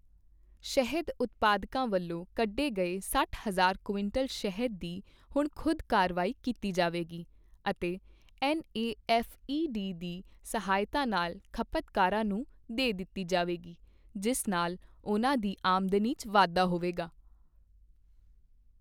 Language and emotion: Punjabi, neutral